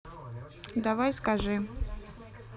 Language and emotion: Russian, neutral